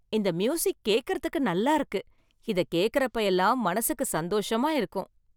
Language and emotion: Tamil, happy